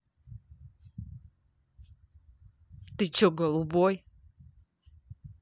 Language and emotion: Russian, angry